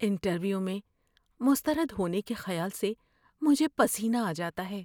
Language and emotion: Urdu, fearful